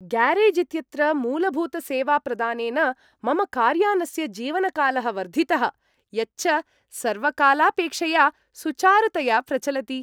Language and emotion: Sanskrit, happy